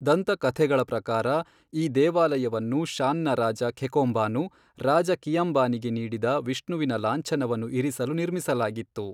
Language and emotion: Kannada, neutral